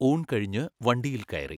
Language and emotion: Malayalam, neutral